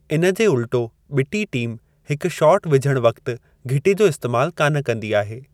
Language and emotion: Sindhi, neutral